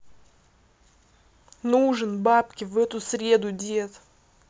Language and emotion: Russian, angry